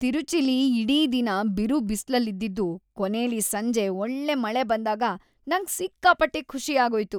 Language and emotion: Kannada, happy